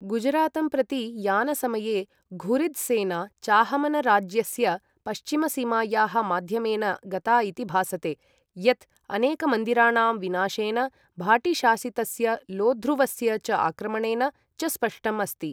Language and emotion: Sanskrit, neutral